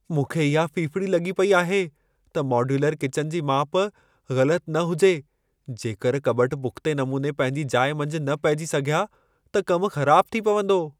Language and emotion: Sindhi, fearful